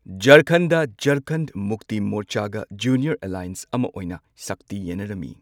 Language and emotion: Manipuri, neutral